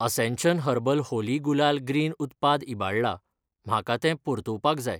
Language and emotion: Goan Konkani, neutral